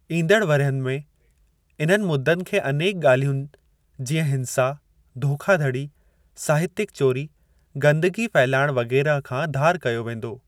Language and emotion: Sindhi, neutral